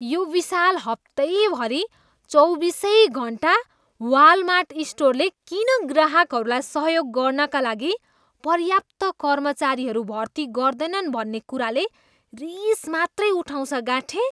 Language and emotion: Nepali, disgusted